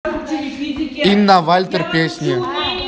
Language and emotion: Russian, neutral